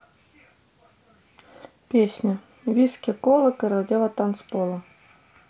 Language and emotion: Russian, neutral